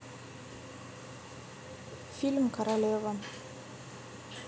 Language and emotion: Russian, neutral